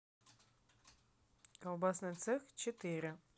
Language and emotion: Russian, neutral